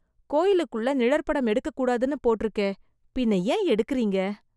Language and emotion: Tamil, disgusted